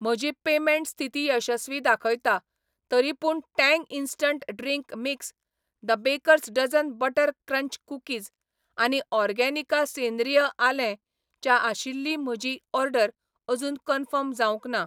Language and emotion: Goan Konkani, neutral